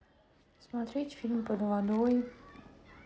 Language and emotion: Russian, sad